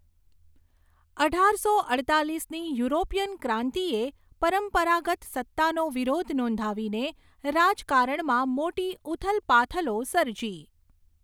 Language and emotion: Gujarati, neutral